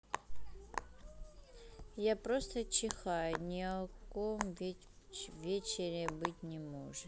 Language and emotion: Russian, neutral